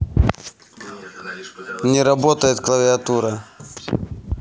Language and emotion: Russian, neutral